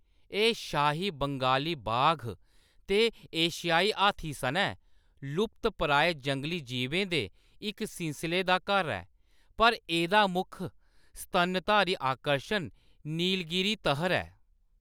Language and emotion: Dogri, neutral